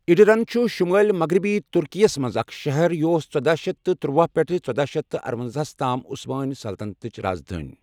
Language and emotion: Kashmiri, neutral